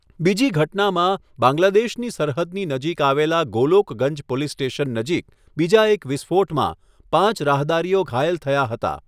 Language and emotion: Gujarati, neutral